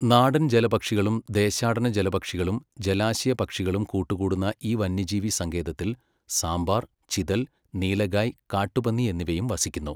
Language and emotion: Malayalam, neutral